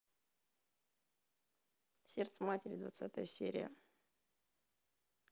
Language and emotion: Russian, neutral